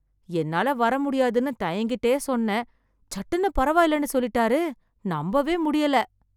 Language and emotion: Tamil, surprised